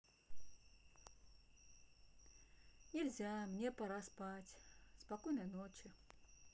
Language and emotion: Russian, sad